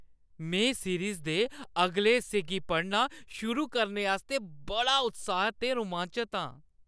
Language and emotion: Dogri, happy